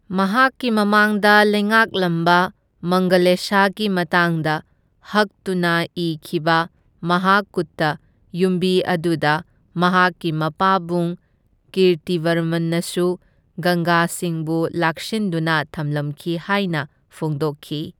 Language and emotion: Manipuri, neutral